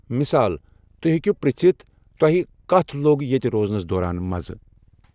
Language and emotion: Kashmiri, neutral